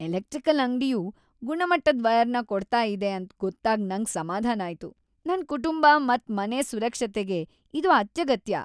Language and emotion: Kannada, happy